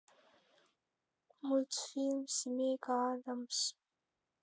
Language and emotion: Russian, sad